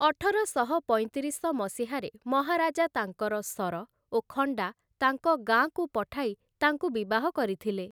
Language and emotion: Odia, neutral